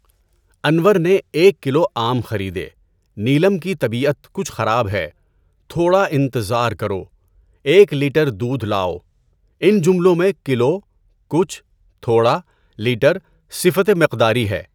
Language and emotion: Urdu, neutral